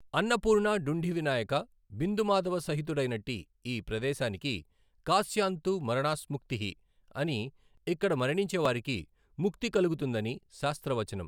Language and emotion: Telugu, neutral